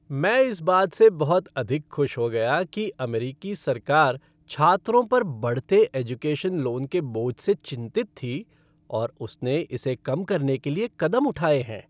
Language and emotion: Hindi, happy